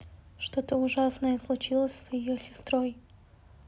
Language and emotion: Russian, neutral